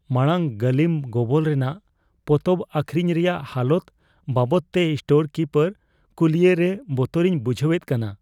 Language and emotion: Santali, fearful